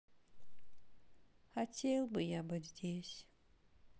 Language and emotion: Russian, sad